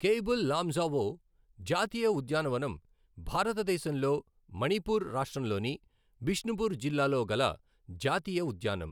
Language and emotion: Telugu, neutral